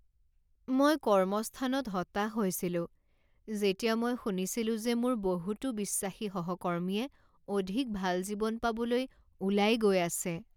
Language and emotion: Assamese, sad